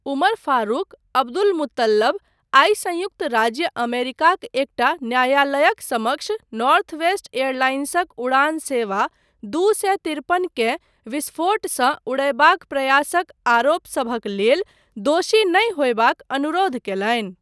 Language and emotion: Maithili, neutral